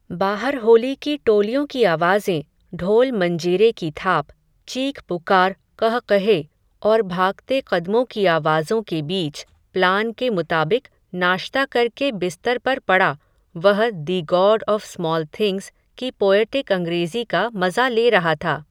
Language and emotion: Hindi, neutral